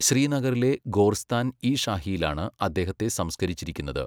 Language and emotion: Malayalam, neutral